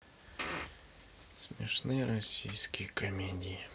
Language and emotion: Russian, sad